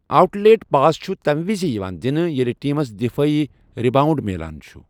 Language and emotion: Kashmiri, neutral